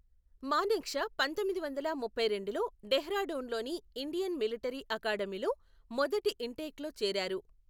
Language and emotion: Telugu, neutral